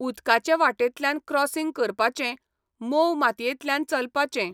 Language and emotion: Goan Konkani, neutral